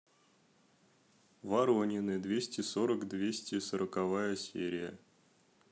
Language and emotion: Russian, neutral